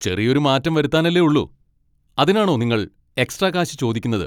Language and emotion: Malayalam, angry